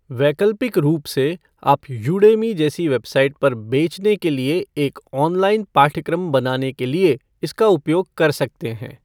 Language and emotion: Hindi, neutral